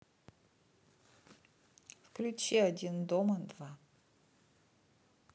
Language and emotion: Russian, neutral